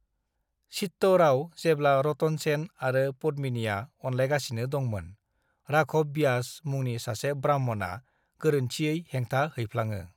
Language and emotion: Bodo, neutral